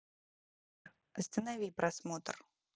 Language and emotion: Russian, neutral